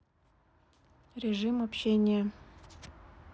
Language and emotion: Russian, sad